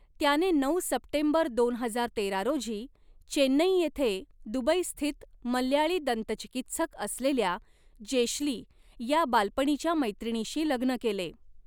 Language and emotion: Marathi, neutral